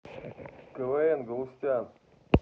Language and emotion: Russian, neutral